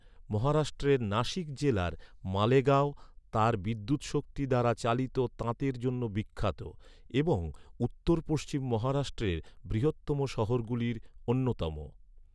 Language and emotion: Bengali, neutral